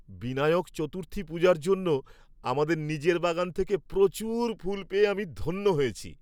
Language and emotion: Bengali, happy